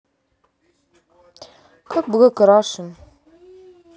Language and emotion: Russian, neutral